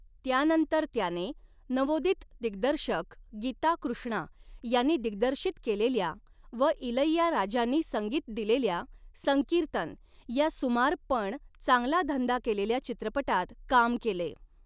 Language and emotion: Marathi, neutral